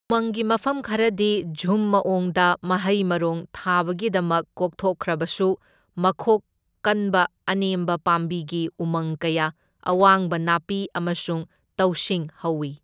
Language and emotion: Manipuri, neutral